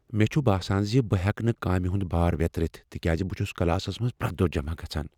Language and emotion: Kashmiri, fearful